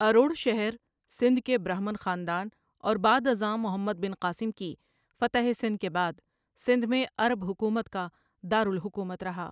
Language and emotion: Urdu, neutral